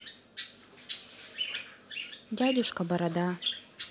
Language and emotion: Russian, neutral